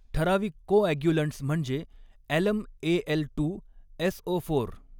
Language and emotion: Marathi, neutral